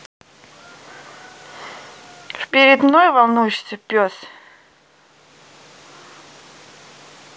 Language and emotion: Russian, neutral